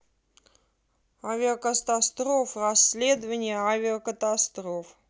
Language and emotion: Russian, neutral